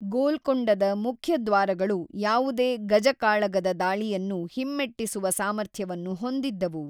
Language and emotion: Kannada, neutral